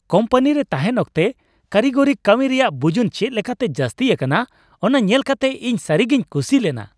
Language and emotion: Santali, happy